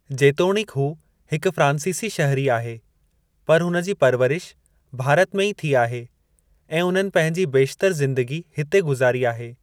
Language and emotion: Sindhi, neutral